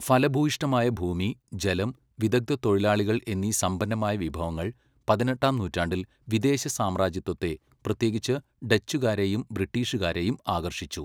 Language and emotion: Malayalam, neutral